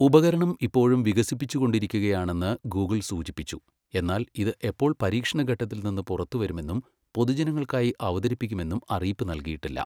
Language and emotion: Malayalam, neutral